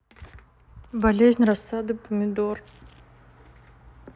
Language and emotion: Russian, neutral